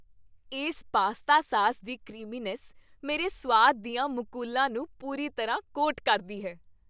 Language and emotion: Punjabi, happy